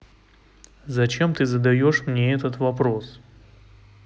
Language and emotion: Russian, neutral